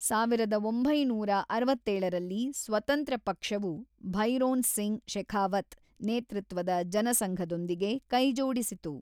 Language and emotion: Kannada, neutral